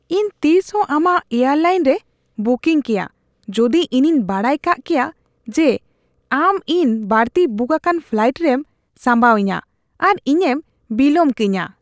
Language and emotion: Santali, disgusted